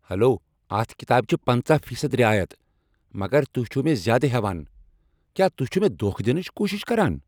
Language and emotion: Kashmiri, angry